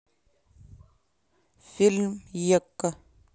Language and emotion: Russian, neutral